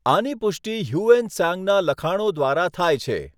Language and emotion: Gujarati, neutral